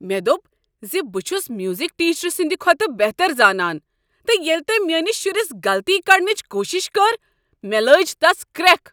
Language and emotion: Kashmiri, angry